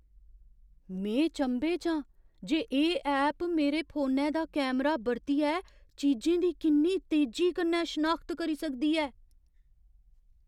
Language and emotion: Dogri, surprised